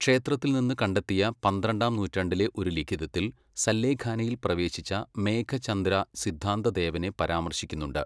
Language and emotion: Malayalam, neutral